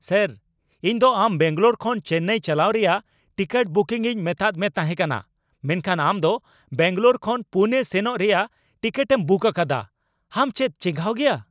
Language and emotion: Santali, angry